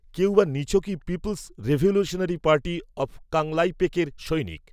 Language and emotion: Bengali, neutral